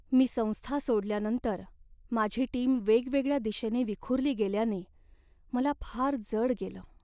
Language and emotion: Marathi, sad